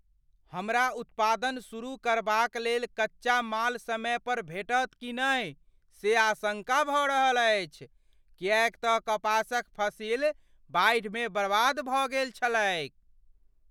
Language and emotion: Maithili, fearful